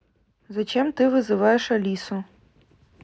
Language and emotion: Russian, neutral